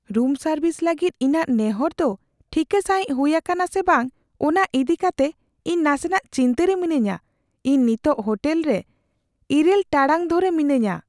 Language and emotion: Santali, fearful